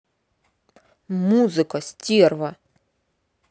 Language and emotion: Russian, angry